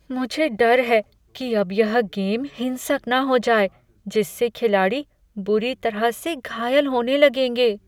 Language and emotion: Hindi, fearful